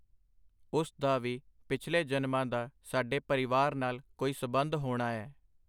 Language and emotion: Punjabi, neutral